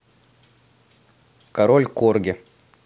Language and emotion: Russian, neutral